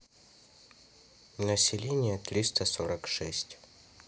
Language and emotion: Russian, neutral